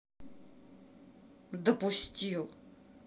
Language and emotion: Russian, angry